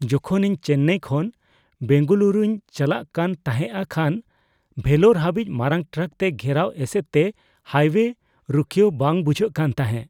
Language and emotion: Santali, fearful